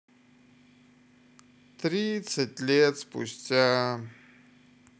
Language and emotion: Russian, sad